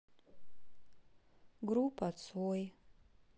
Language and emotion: Russian, sad